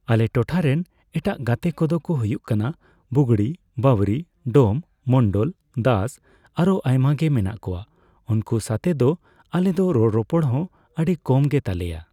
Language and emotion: Santali, neutral